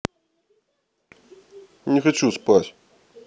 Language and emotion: Russian, neutral